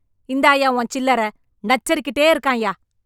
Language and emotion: Tamil, angry